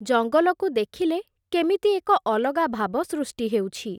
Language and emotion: Odia, neutral